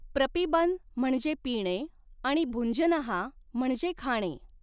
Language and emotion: Marathi, neutral